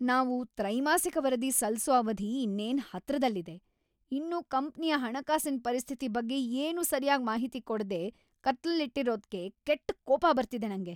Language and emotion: Kannada, angry